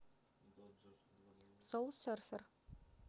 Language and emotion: Russian, neutral